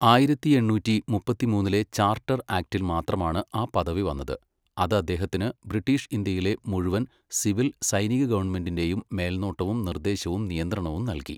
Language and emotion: Malayalam, neutral